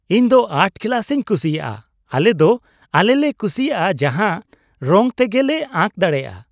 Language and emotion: Santali, happy